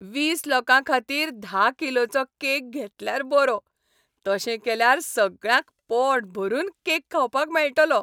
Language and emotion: Goan Konkani, happy